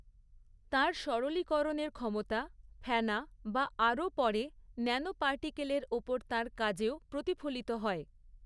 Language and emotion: Bengali, neutral